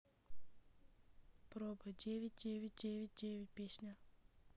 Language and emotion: Russian, neutral